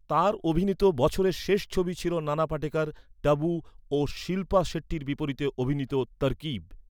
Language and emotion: Bengali, neutral